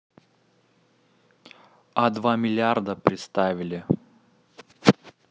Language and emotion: Russian, neutral